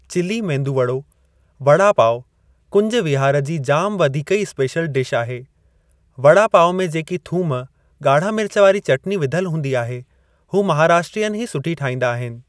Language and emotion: Sindhi, neutral